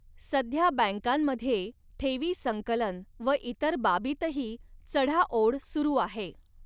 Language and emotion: Marathi, neutral